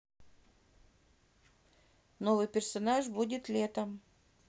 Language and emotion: Russian, neutral